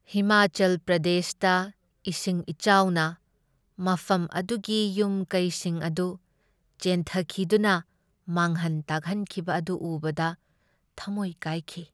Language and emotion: Manipuri, sad